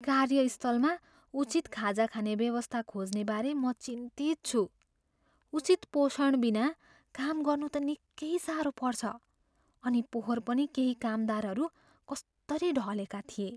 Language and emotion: Nepali, fearful